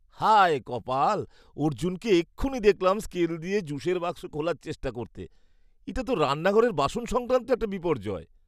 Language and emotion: Bengali, disgusted